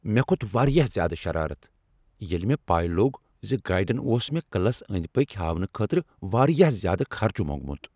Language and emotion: Kashmiri, angry